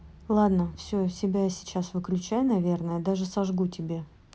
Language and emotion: Russian, neutral